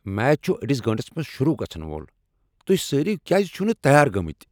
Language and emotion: Kashmiri, angry